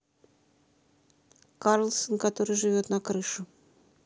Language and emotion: Russian, neutral